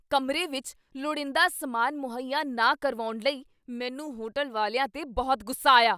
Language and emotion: Punjabi, angry